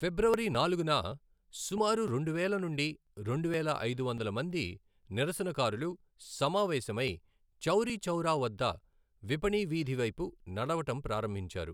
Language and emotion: Telugu, neutral